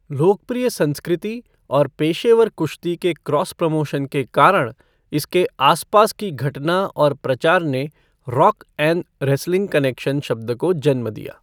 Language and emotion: Hindi, neutral